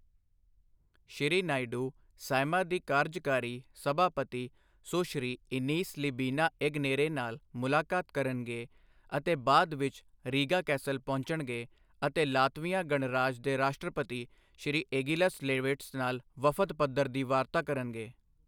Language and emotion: Punjabi, neutral